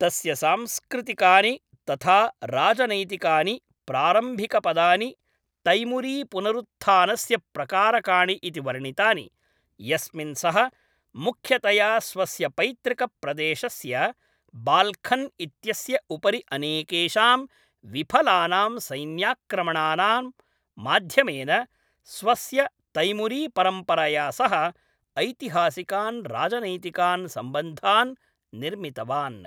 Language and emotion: Sanskrit, neutral